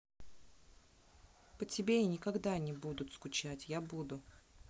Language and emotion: Russian, neutral